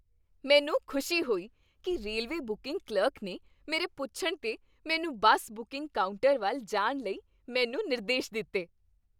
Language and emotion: Punjabi, happy